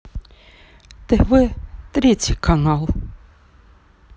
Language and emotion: Russian, sad